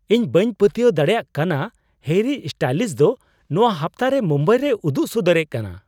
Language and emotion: Santali, surprised